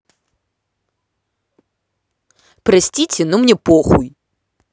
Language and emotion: Russian, angry